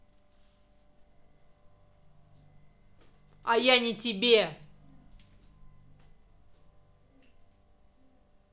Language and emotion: Russian, angry